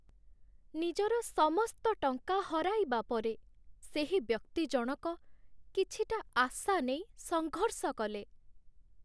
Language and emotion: Odia, sad